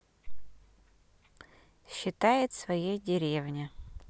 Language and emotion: Russian, neutral